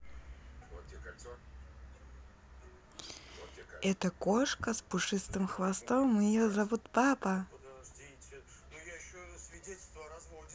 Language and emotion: Russian, positive